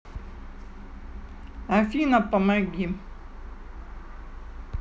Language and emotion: Russian, neutral